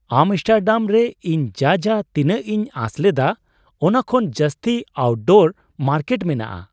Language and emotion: Santali, surprised